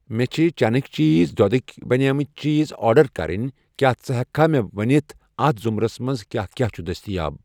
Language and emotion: Kashmiri, neutral